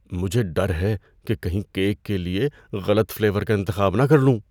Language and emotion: Urdu, fearful